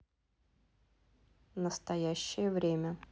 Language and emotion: Russian, neutral